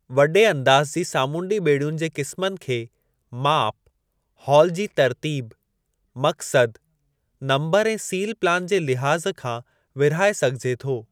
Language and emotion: Sindhi, neutral